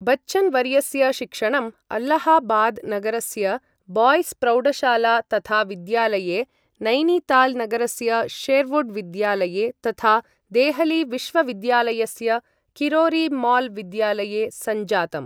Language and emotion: Sanskrit, neutral